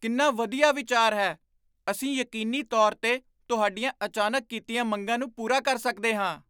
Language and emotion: Punjabi, surprised